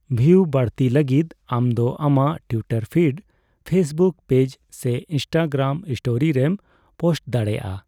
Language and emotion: Santali, neutral